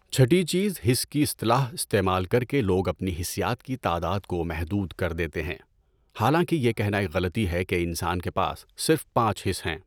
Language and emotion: Urdu, neutral